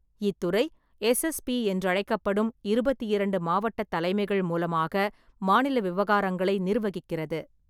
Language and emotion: Tamil, neutral